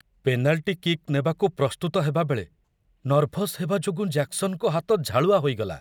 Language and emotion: Odia, fearful